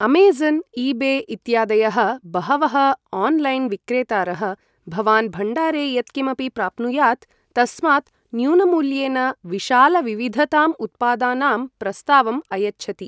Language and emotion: Sanskrit, neutral